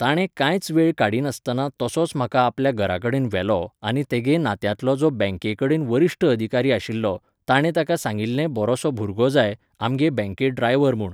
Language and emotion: Goan Konkani, neutral